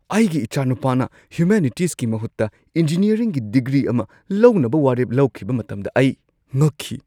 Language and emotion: Manipuri, surprised